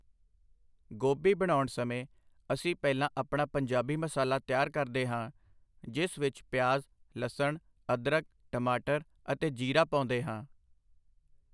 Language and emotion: Punjabi, neutral